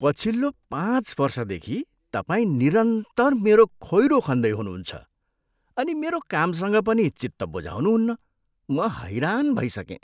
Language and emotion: Nepali, disgusted